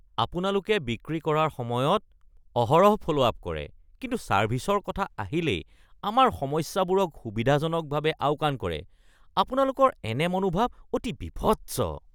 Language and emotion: Assamese, disgusted